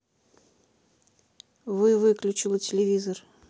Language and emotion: Russian, neutral